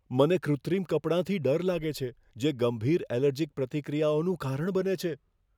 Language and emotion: Gujarati, fearful